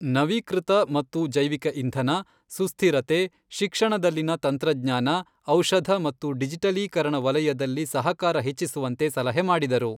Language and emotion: Kannada, neutral